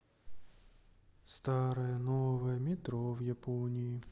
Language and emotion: Russian, sad